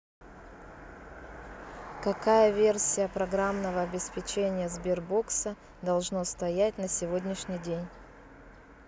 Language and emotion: Russian, neutral